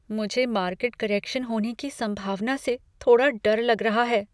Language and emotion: Hindi, fearful